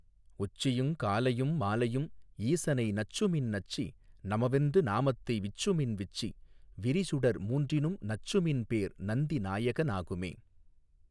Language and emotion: Tamil, neutral